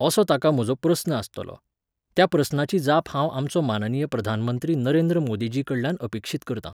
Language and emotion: Goan Konkani, neutral